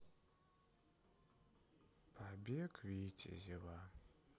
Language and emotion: Russian, sad